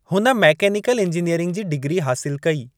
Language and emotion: Sindhi, neutral